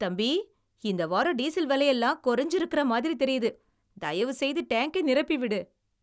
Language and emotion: Tamil, happy